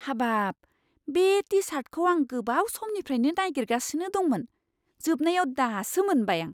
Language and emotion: Bodo, surprised